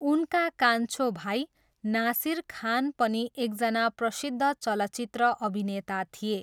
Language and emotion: Nepali, neutral